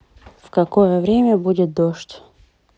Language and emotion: Russian, neutral